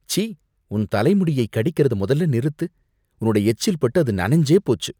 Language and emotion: Tamil, disgusted